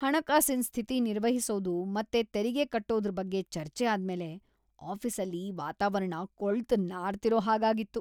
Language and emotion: Kannada, disgusted